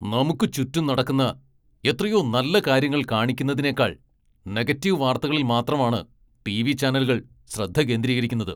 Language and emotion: Malayalam, angry